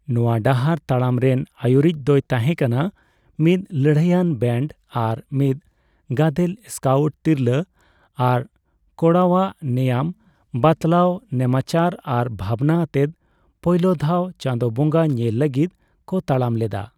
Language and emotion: Santali, neutral